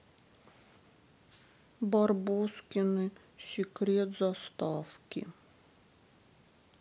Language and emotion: Russian, sad